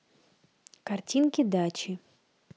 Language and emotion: Russian, neutral